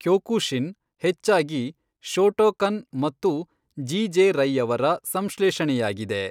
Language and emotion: Kannada, neutral